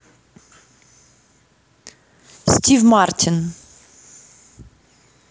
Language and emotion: Russian, neutral